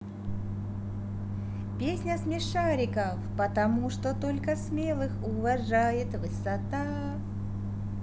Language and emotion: Russian, positive